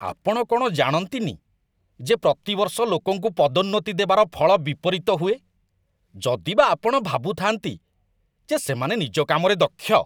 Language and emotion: Odia, disgusted